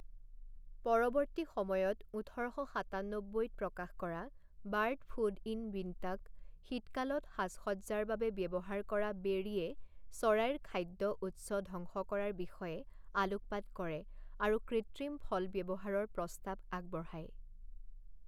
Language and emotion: Assamese, neutral